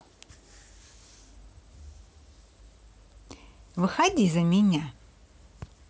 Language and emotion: Russian, positive